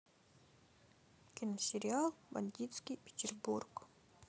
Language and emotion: Russian, neutral